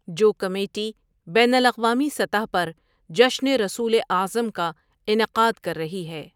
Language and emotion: Urdu, neutral